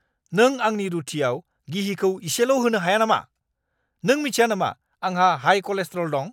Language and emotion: Bodo, angry